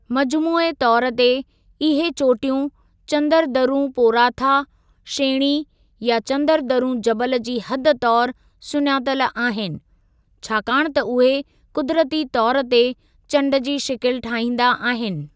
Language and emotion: Sindhi, neutral